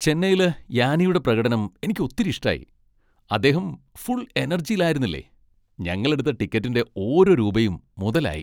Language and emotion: Malayalam, happy